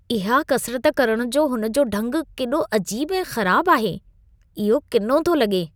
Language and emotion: Sindhi, disgusted